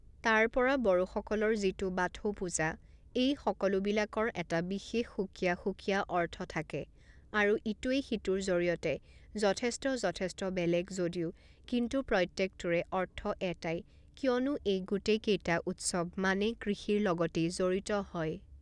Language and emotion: Assamese, neutral